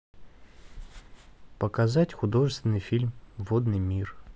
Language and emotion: Russian, neutral